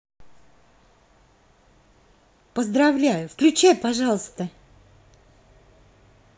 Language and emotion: Russian, positive